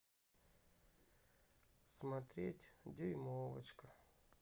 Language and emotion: Russian, sad